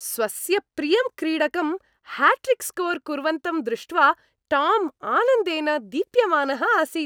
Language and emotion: Sanskrit, happy